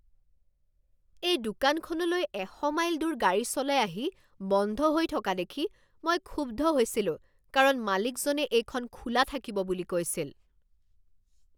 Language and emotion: Assamese, angry